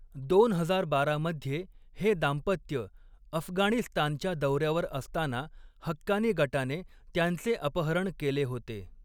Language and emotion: Marathi, neutral